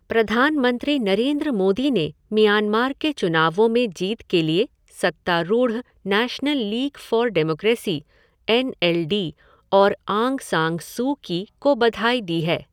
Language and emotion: Hindi, neutral